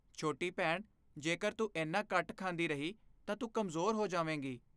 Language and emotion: Punjabi, fearful